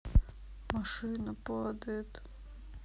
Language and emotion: Russian, sad